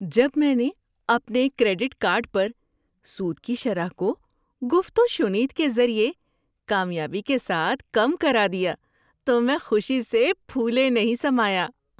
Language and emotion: Urdu, happy